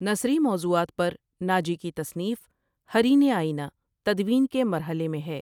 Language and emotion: Urdu, neutral